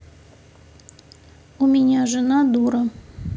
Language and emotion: Russian, neutral